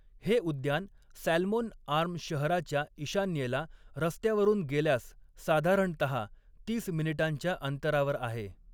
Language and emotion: Marathi, neutral